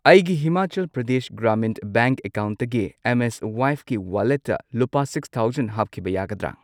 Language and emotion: Manipuri, neutral